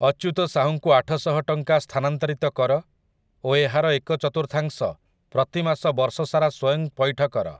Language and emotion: Odia, neutral